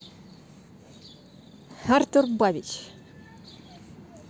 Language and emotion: Russian, neutral